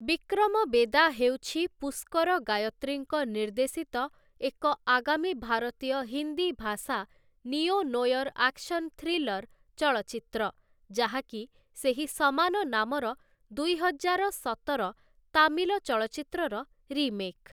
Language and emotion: Odia, neutral